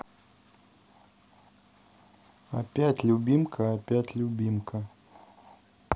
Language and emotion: Russian, neutral